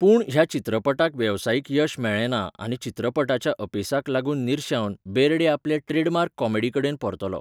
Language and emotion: Goan Konkani, neutral